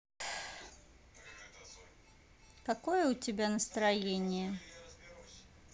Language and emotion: Russian, neutral